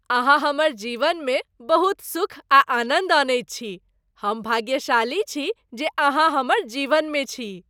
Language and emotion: Maithili, happy